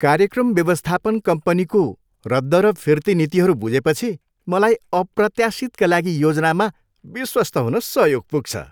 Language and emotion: Nepali, happy